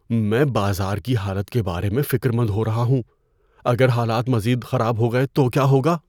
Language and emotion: Urdu, fearful